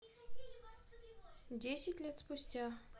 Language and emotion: Russian, neutral